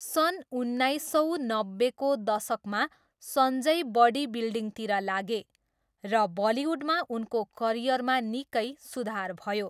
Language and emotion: Nepali, neutral